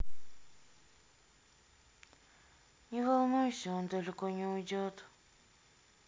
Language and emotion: Russian, sad